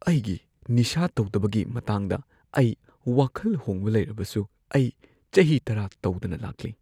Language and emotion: Manipuri, fearful